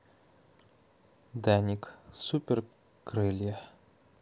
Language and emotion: Russian, neutral